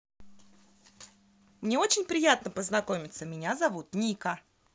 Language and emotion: Russian, positive